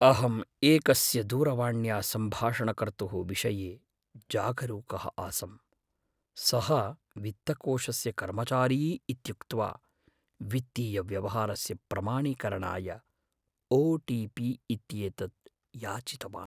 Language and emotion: Sanskrit, fearful